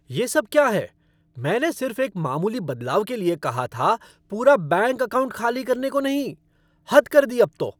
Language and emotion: Hindi, angry